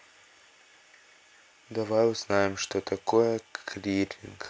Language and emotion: Russian, neutral